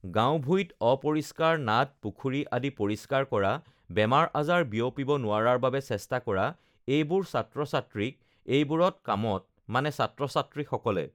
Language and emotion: Assamese, neutral